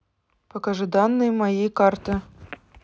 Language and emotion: Russian, neutral